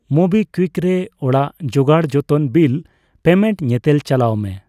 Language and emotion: Santali, neutral